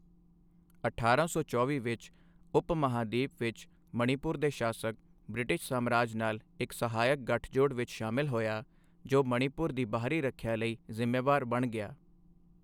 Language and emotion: Punjabi, neutral